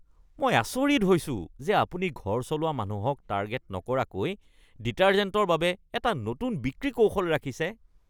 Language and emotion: Assamese, disgusted